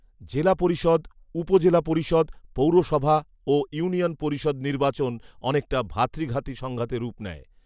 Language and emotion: Bengali, neutral